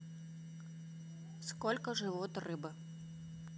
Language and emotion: Russian, neutral